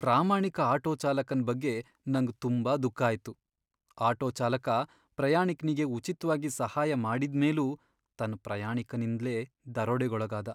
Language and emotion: Kannada, sad